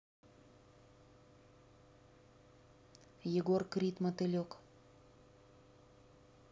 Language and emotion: Russian, neutral